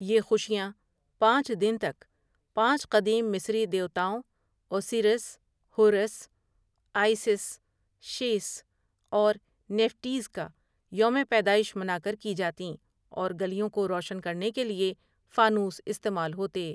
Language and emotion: Urdu, neutral